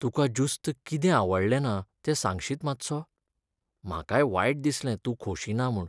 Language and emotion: Goan Konkani, sad